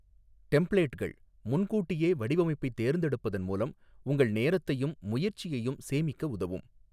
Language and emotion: Tamil, neutral